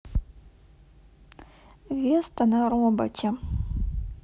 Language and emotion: Russian, sad